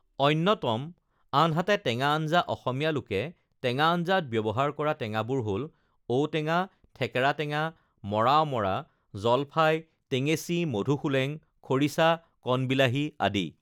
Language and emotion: Assamese, neutral